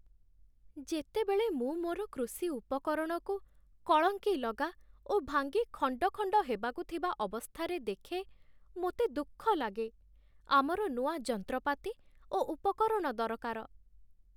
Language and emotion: Odia, sad